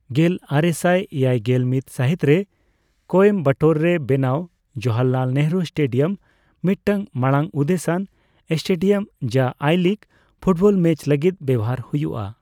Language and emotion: Santali, neutral